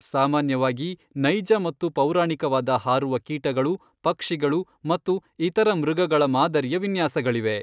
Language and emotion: Kannada, neutral